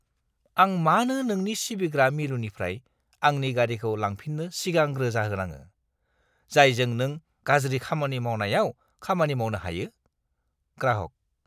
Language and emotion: Bodo, disgusted